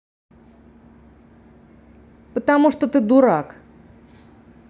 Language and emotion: Russian, angry